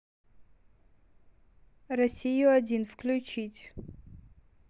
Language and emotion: Russian, neutral